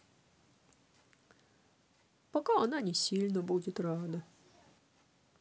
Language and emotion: Russian, sad